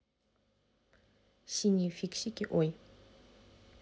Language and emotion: Russian, neutral